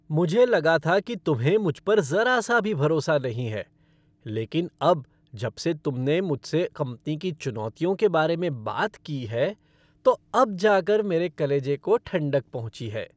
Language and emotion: Hindi, happy